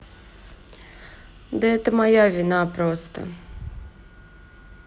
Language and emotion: Russian, sad